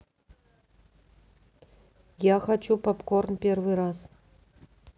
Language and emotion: Russian, neutral